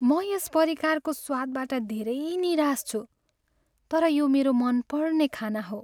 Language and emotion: Nepali, sad